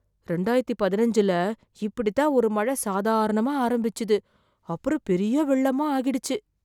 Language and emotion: Tamil, fearful